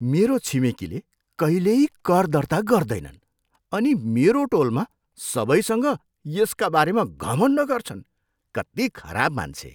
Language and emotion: Nepali, disgusted